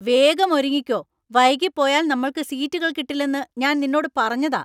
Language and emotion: Malayalam, angry